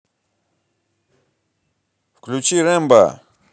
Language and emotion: Russian, positive